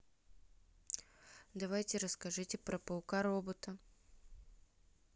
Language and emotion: Russian, neutral